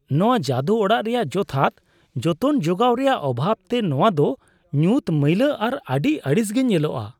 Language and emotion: Santali, disgusted